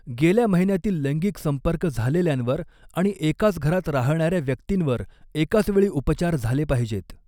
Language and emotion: Marathi, neutral